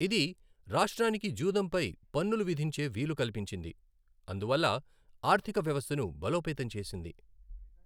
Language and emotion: Telugu, neutral